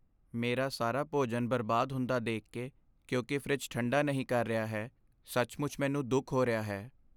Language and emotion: Punjabi, sad